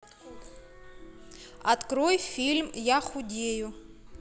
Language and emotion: Russian, neutral